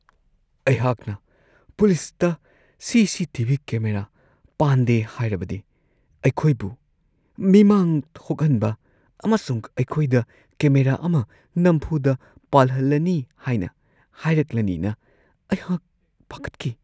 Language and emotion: Manipuri, fearful